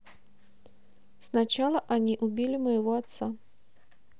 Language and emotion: Russian, neutral